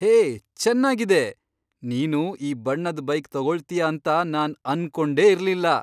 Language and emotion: Kannada, surprised